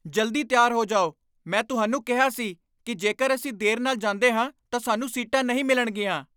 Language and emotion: Punjabi, angry